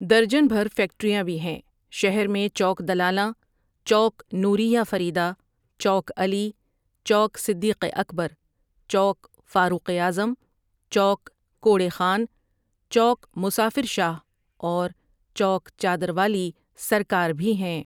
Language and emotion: Urdu, neutral